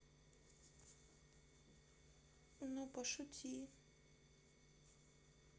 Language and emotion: Russian, sad